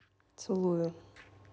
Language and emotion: Russian, neutral